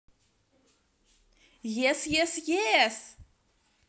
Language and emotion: Russian, positive